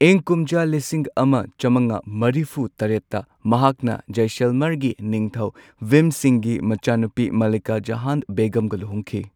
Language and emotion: Manipuri, neutral